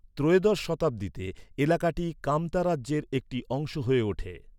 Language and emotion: Bengali, neutral